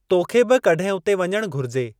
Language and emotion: Sindhi, neutral